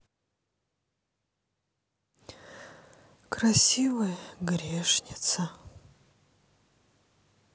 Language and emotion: Russian, sad